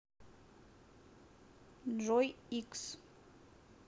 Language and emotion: Russian, neutral